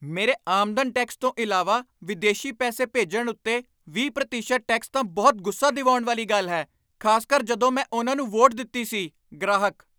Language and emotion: Punjabi, angry